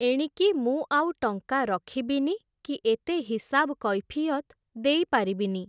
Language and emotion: Odia, neutral